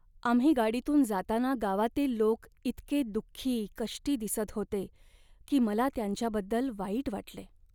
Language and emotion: Marathi, sad